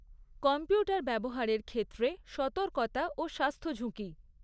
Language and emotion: Bengali, neutral